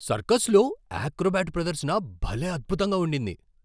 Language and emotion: Telugu, surprised